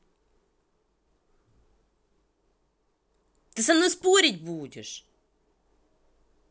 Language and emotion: Russian, angry